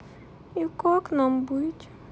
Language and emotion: Russian, sad